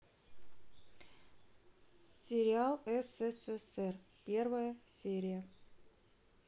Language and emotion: Russian, neutral